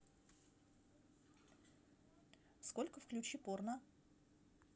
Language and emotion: Russian, neutral